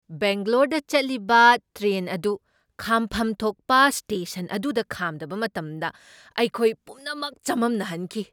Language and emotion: Manipuri, surprised